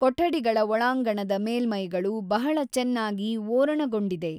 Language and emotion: Kannada, neutral